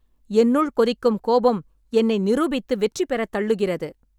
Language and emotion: Tamil, angry